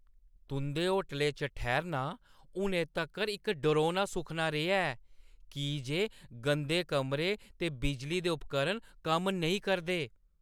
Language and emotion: Dogri, angry